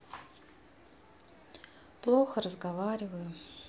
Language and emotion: Russian, sad